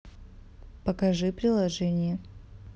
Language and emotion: Russian, neutral